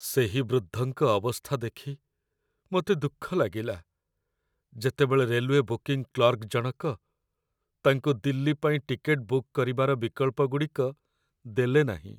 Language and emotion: Odia, sad